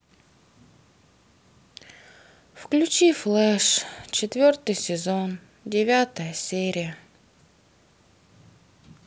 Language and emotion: Russian, sad